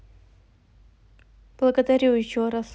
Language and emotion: Russian, neutral